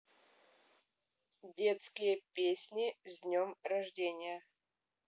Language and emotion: Russian, neutral